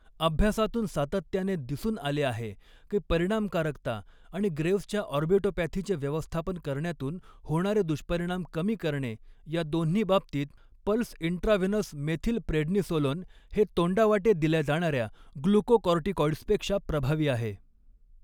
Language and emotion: Marathi, neutral